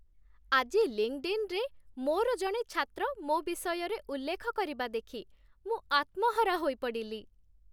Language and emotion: Odia, happy